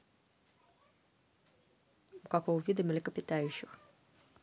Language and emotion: Russian, neutral